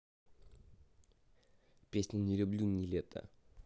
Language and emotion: Russian, neutral